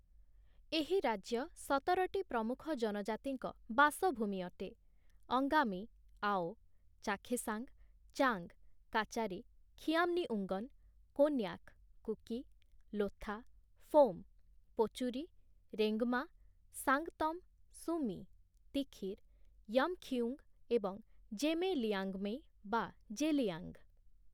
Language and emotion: Odia, neutral